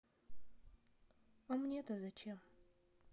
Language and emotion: Russian, sad